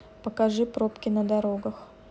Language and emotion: Russian, neutral